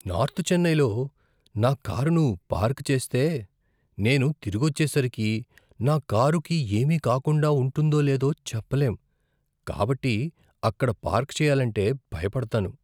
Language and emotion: Telugu, fearful